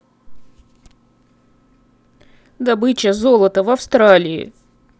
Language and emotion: Russian, sad